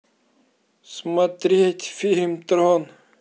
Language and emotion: Russian, sad